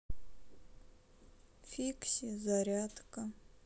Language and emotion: Russian, sad